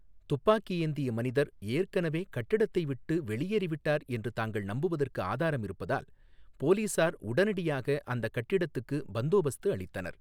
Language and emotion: Tamil, neutral